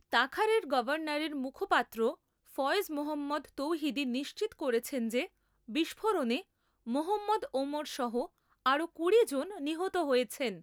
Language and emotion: Bengali, neutral